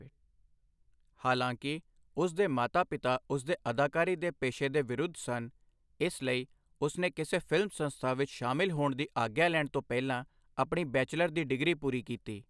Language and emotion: Punjabi, neutral